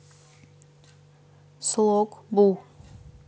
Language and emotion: Russian, neutral